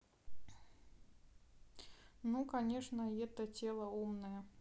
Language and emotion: Russian, neutral